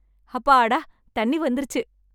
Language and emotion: Tamil, happy